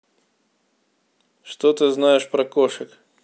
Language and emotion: Russian, neutral